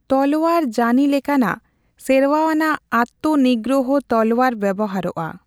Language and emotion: Santali, neutral